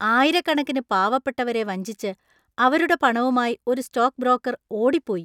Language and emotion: Malayalam, disgusted